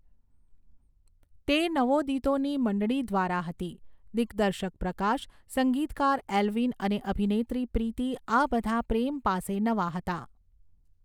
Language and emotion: Gujarati, neutral